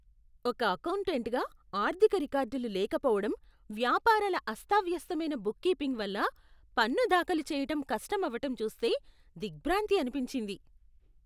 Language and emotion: Telugu, disgusted